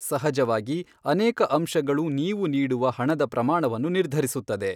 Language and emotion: Kannada, neutral